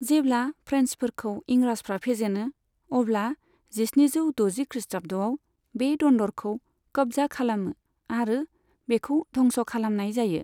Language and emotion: Bodo, neutral